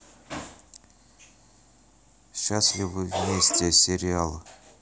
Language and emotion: Russian, neutral